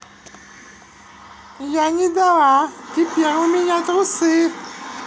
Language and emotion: Russian, positive